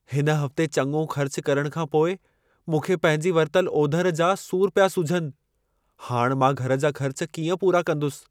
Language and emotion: Sindhi, fearful